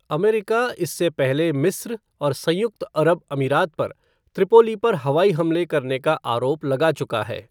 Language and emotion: Hindi, neutral